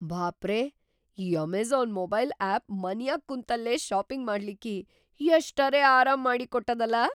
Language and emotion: Kannada, surprised